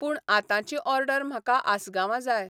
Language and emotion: Goan Konkani, neutral